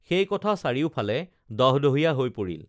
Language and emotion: Assamese, neutral